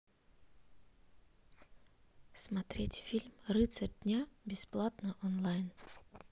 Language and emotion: Russian, neutral